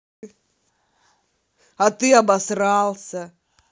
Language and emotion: Russian, neutral